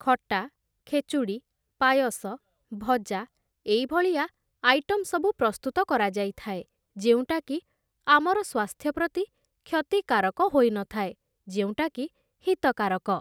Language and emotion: Odia, neutral